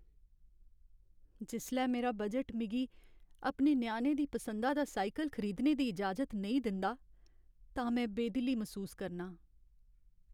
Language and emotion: Dogri, sad